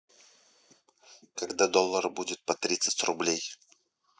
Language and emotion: Russian, neutral